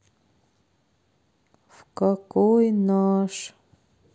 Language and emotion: Russian, sad